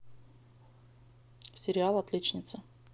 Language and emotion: Russian, neutral